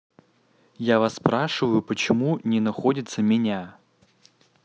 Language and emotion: Russian, neutral